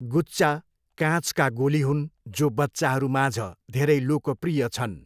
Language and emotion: Nepali, neutral